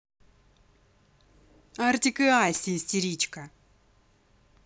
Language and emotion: Russian, angry